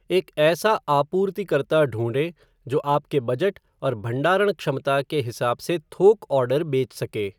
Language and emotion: Hindi, neutral